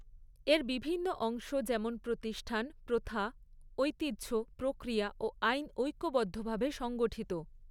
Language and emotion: Bengali, neutral